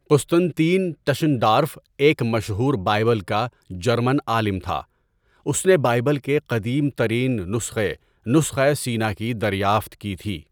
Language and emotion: Urdu, neutral